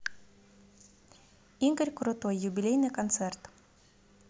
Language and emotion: Russian, positive